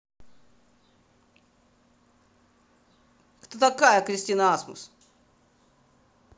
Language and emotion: Russian, angry